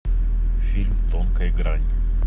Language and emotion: Russian, neutral